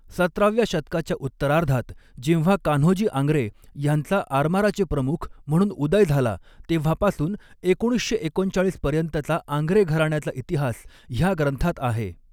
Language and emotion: Marathi, neutral